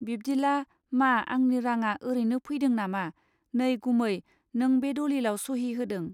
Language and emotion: Bodo, neutral